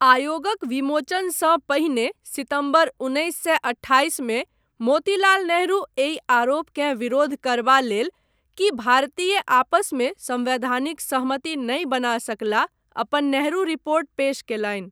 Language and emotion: Maithili, neutral